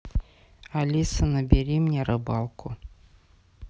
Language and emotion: Russian, neutral